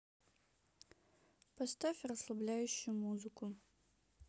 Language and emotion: Russian, sad